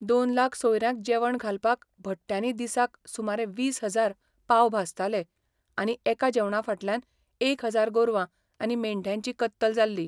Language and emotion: Goan Konkani, neutral